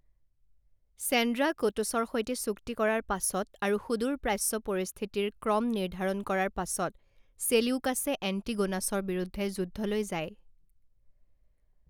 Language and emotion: Assamese, neutral